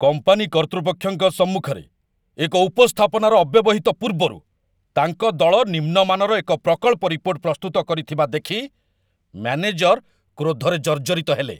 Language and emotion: Odia, angry